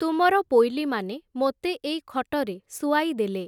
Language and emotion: Odia, neutral